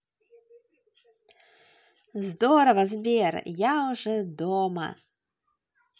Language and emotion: Russian, positive